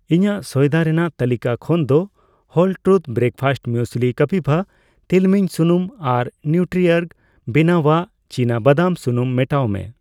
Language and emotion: Santali, neutral